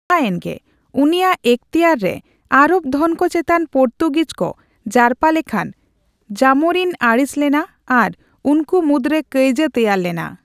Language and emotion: Santali, neutral